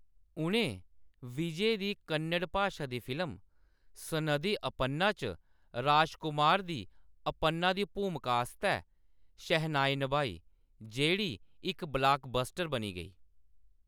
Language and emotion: Dogri, neutral